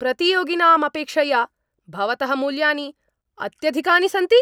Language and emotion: Sanskrit, angry